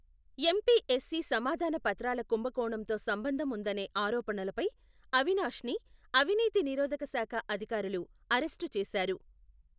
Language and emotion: Telugu, neutral